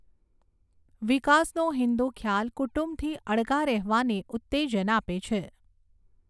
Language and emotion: Gujarati, neutral